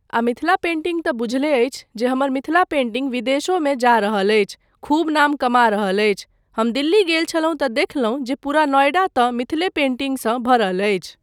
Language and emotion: Maithili, neutral